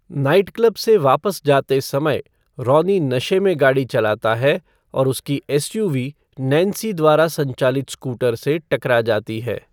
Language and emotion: Hindi, neutral